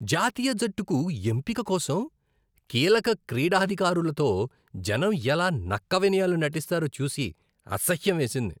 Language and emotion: Telugu, disgusted